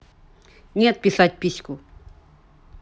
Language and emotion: Russian, angry